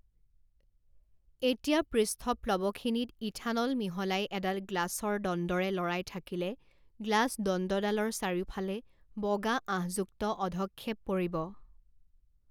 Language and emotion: Assamese, neutral